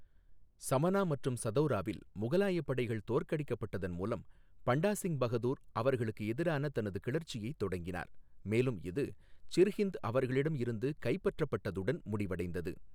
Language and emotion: Tamil, neutral